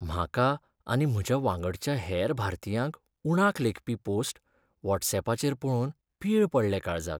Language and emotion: Goan Konkani, sad